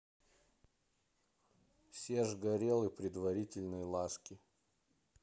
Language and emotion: Russian, neutral